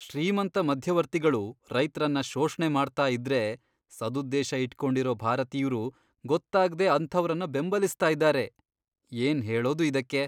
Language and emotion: Kannada, disgusted